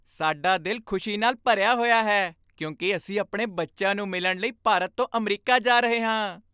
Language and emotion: Punjabi, happy